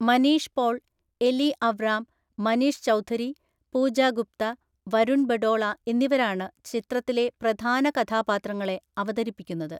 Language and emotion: Malayalam, neutral